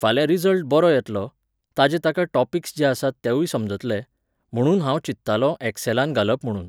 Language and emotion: Goan Konkani, neutral